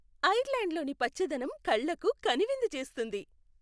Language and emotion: Telugu, happy